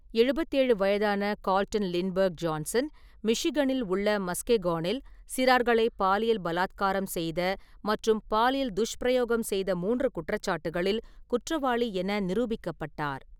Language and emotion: Tamil, neutral